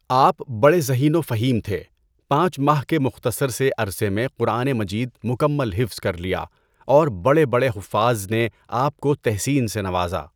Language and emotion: Urdu, neutral